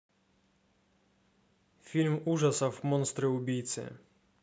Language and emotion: Russian, neutral